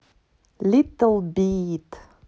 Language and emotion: Russian, positive